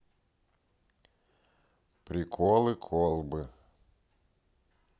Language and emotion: Russian, neutral